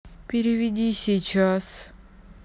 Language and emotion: Russian, sad